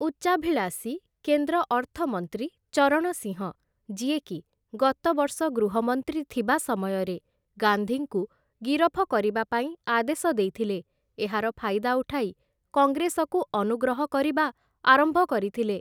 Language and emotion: Odia, neutral